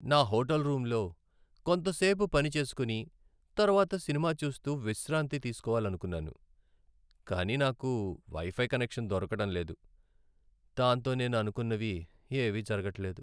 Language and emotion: Telugu, sad